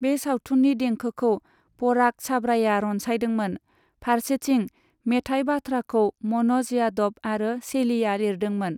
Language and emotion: Bodo, neutral